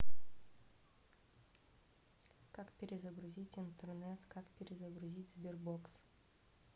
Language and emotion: Russian, neutral